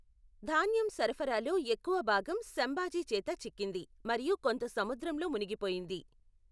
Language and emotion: Telugu, neutral